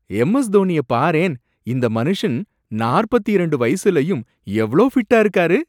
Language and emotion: Tamil, surprised